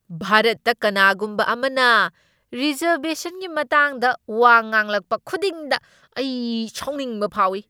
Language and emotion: Manipuri, angry